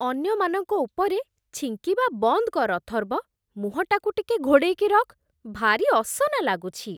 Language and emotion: Odia, disgusted